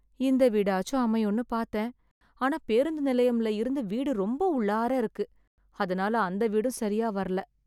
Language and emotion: Tamil, sad